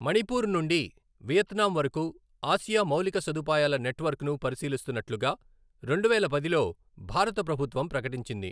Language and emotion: Telugu, neutral